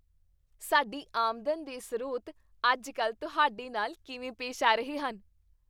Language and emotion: Punjabi, happy